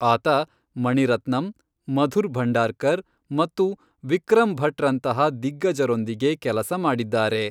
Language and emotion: Kannada, neutral